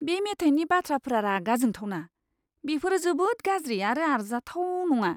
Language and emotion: Bodo, disgusted